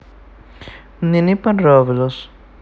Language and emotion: Russian, neutral